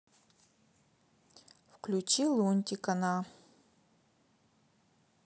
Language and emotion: Russian, neutral